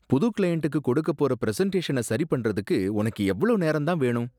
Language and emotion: Tamil, disgusted